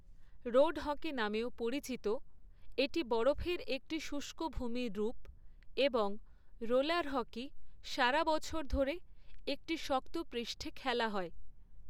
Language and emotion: Bengali, neutral